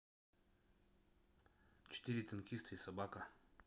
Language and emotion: Russian, neutral